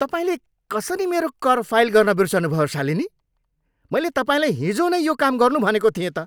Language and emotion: Nepali, angry